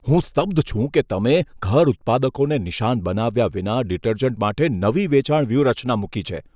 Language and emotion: Gujarati, disgusted